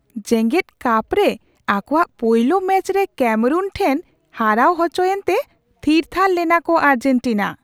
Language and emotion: Santali, surprised